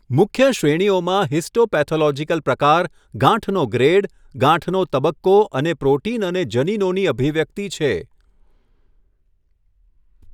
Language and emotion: Gujarati, neutral